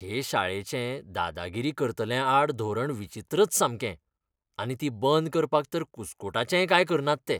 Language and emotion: Goan Konkani, disgusted